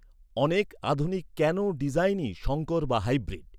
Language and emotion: Bengali, neutral